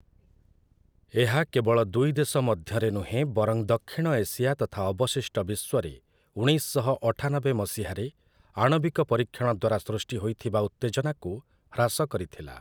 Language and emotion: Odia, neutral